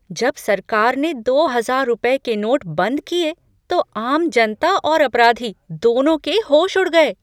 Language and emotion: Hindi, surprised